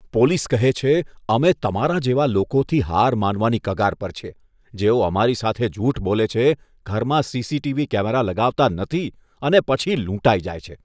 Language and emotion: Gujarati, disgusted